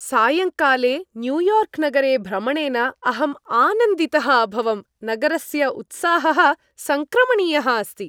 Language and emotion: Sanskrit, happy